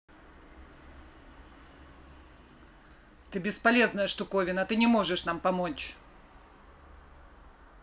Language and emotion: Russian, angry